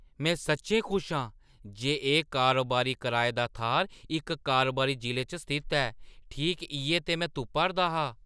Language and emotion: Dogri, surprised